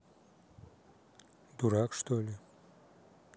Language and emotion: Russian, neutral